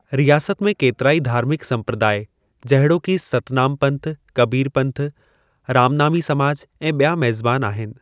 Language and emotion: Sindhi, neutral